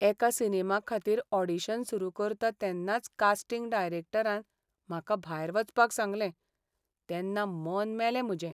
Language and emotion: Goan Konkani, sad